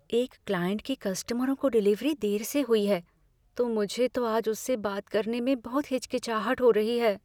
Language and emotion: Hindi, fearful